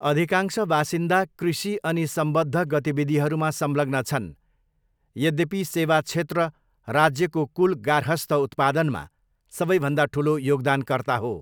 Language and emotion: Nepali, neutral